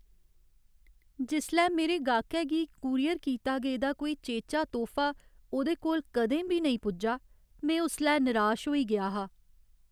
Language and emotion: Dogri, sad